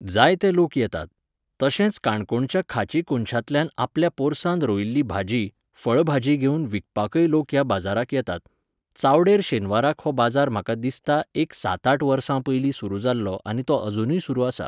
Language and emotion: Goan Konkani, neutral